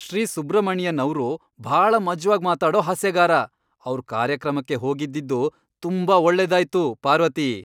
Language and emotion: Kannada, happy